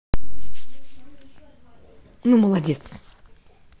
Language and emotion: Russian, positive